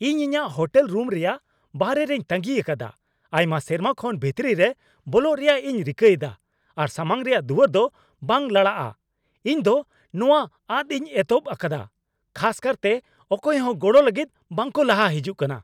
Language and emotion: Santali, angry